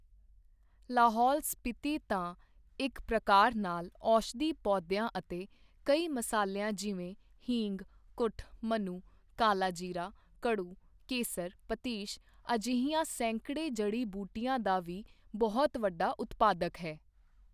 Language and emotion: Punjabi, neutral